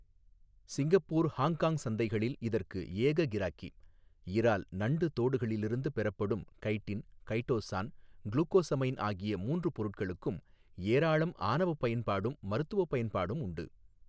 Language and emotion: Tamil, neutral